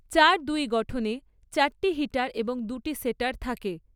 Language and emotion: Bengali, neutral